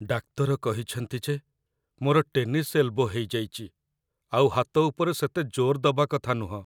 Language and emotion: Odia, sad